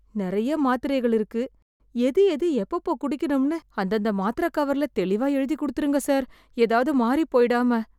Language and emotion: Tamil, fearful